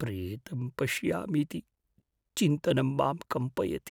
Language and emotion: Sanskrit, fearful